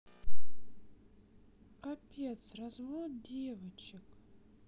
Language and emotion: Russian, sad